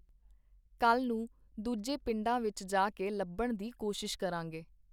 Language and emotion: Punjabi, neutral